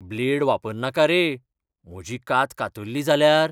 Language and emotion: Goan Konkani, fearful